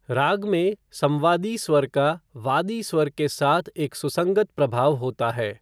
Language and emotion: Hindi, neutral